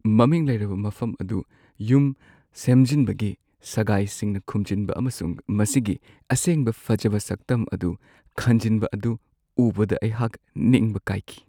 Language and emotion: Manipuri, sad